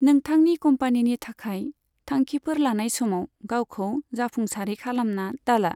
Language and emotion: Bodo, neutral